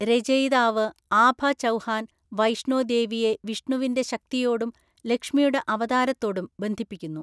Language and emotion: Malayalam, neutral